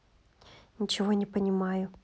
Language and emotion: Russian, neutral